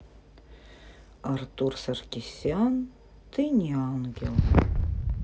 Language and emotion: Russian, sad